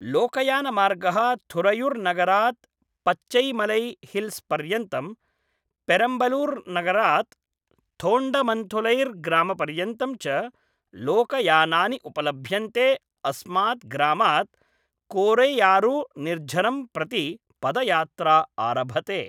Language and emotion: Sanskrit, neutral